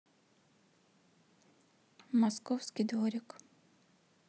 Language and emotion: Russian, neutral